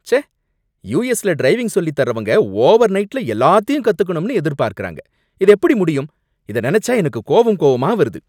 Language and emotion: Tamil, angry